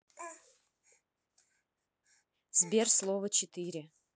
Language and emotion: Russian, neutral